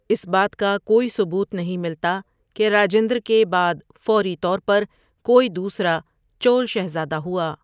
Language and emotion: Urdu, neutral